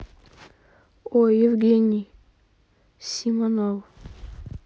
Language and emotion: Russian, neutral